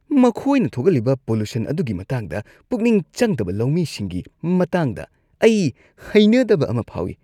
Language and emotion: Manipuri, disgusted